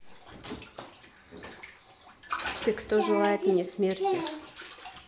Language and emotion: Russian, neutral